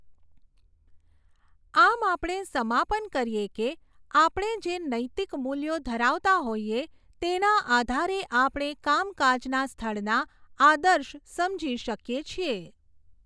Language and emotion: Gujarati, neutral